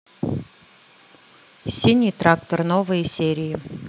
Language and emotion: Russian, neutral